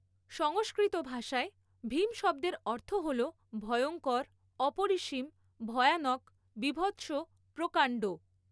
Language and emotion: Bengali, neutral